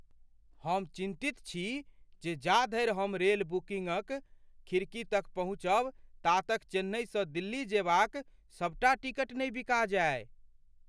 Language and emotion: Maithili, fearful